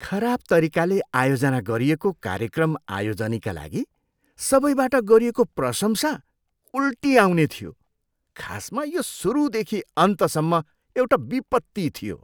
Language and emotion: Nepali, disgusted